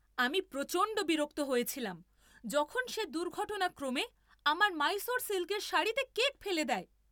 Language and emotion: Bengali, angry